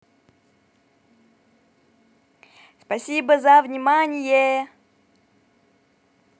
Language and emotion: Russian, positive